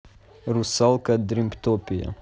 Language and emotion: Russian, neutral